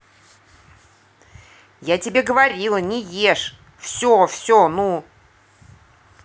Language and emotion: Russian, angry